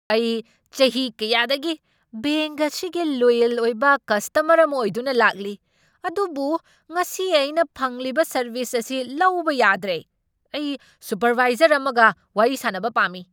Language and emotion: Manipuri, angry